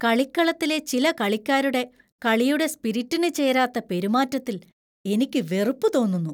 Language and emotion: Malayalam, disgusted